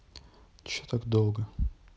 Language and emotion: Russian, neutral